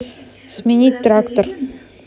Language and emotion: Russian, neutral